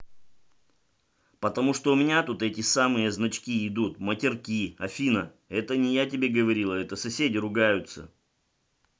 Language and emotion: Russian, angry